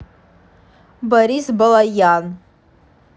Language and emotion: Russian, neutral